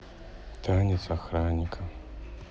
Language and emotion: Russian, sad